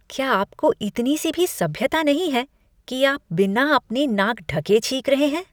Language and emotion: Hindi, disgusted